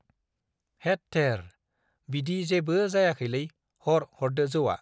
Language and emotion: Bodo, neutral